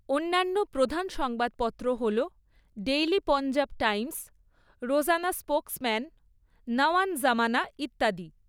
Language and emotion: Bengali, neutral